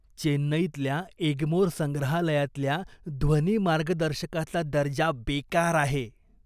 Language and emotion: Marathi, disgusted